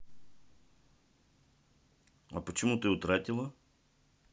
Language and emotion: Russian, neutral